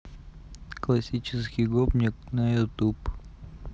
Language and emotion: Russian, neutral